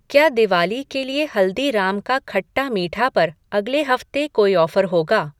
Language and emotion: Hindi, neutral